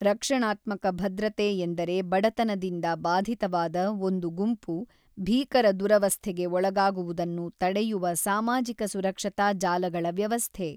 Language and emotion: Kannada, neutral